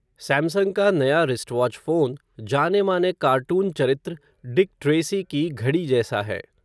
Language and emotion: Hindi, neutral